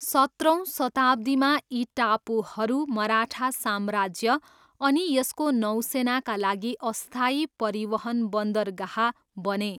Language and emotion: Nepali, neutral